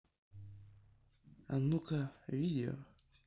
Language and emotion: Russian, neutral